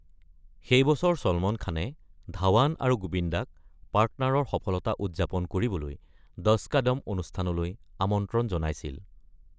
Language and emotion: Assamese, neutral